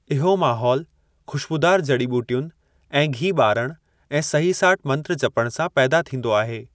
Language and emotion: Sindhi, neutral